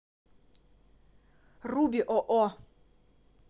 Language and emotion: Russian, neutral